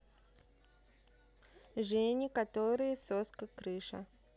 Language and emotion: Russian, neutral